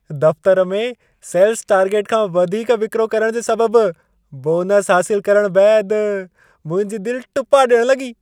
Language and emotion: Sindhi, happy